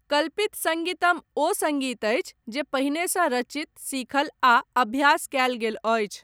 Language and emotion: Maithili, neutral